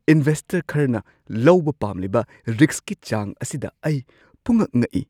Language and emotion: Manipuri, surprised